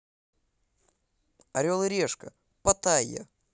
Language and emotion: Russian, positive